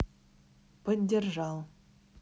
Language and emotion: Russian, neutral